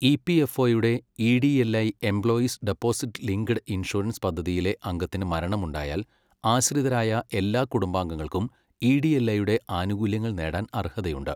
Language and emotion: Malayalam, neutral